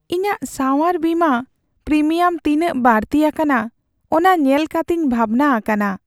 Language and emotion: Santali, sad